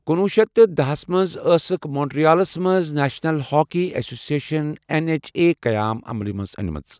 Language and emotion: Kashmiri, neutral